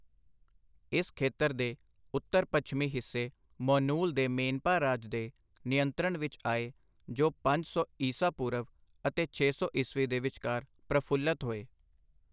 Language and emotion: Punjabi, neutral